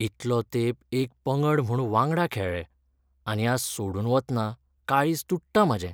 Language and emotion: Goan Konkani, sad